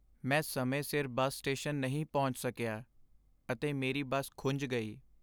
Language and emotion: Punjabi, sad